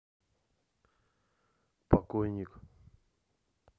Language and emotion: Russian, neutral